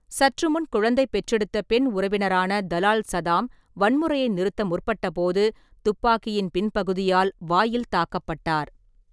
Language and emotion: Tamil, neutral